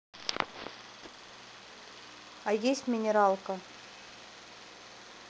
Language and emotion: Russian, neutral